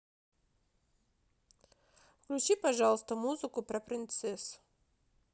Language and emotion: Russian, neutral